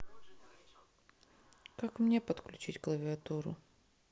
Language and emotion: Russian, sad